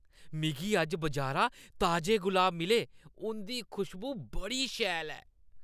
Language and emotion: Dogri, happy